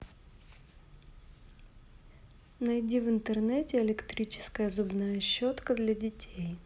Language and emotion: Russian, neutral